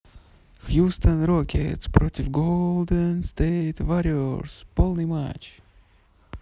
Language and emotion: Russian, positive